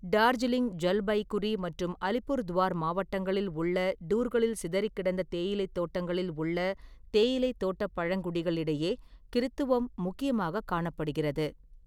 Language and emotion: Tamil, neutral